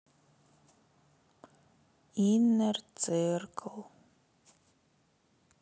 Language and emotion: Russian, sad